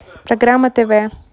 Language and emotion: Russian, neutral